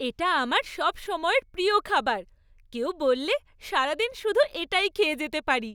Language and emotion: Bengali, happy